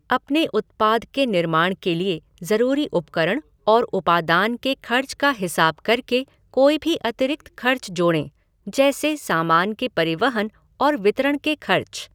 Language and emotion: Hindi, neutral